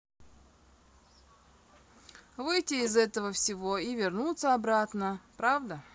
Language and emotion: Russian, neutral